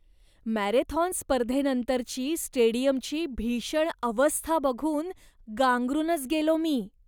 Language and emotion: Marathi, disgusted